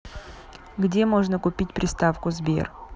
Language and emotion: Russian, neutral